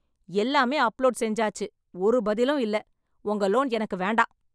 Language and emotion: Tamil, angry